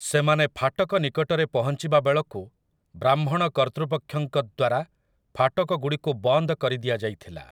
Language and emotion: Odia, neutral